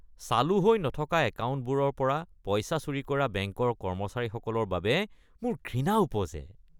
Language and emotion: Assamese, disgusted